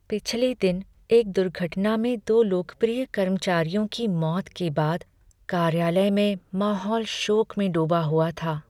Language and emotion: Hindi, sad